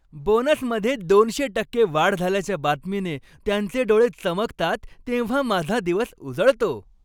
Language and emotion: Marathi, happy